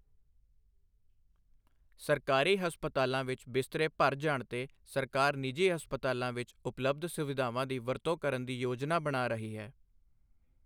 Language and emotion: Punjabi, neutral